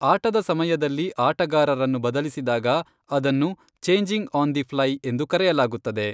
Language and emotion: Kannada, neutral